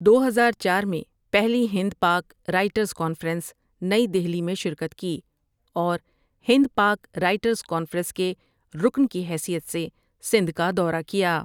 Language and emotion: Urdu, neutral